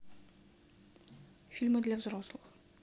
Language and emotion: Russian, neutral